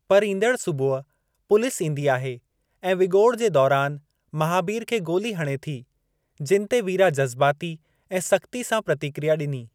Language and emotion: Sindhi, neutral